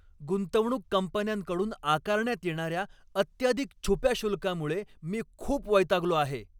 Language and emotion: Marathi, angry